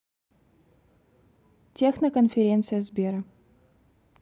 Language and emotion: Russian, neutral